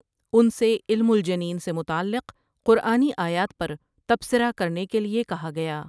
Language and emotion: Urdu, neutral